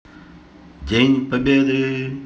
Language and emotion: Russian, neutral